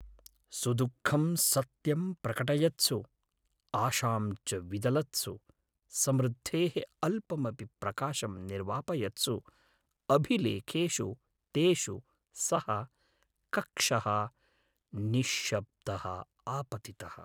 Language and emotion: Sanskrit, sad